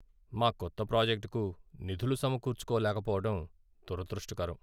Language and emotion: Telugu, sad